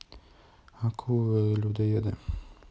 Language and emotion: Russian, neutral